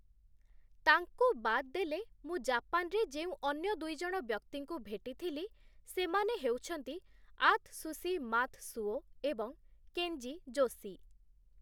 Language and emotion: Odia, neutral